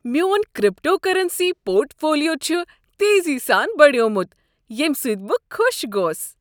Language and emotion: Kashmiri, happy